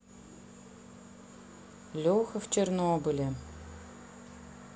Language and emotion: Russian, neutral